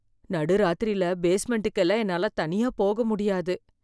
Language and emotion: Tamil, fearful